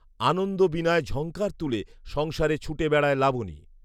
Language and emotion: Bengali, neutral